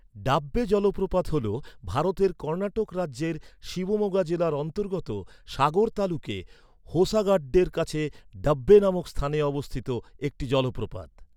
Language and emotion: Bengali, neutral